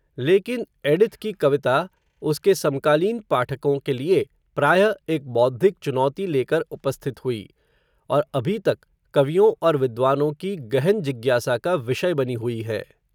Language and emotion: Hindi, neutral